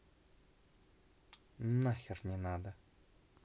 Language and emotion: Russian, angry